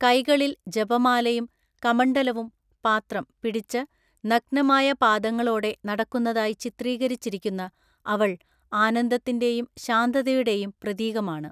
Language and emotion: Malayalam, neutral